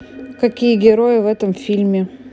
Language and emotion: Russian, neutral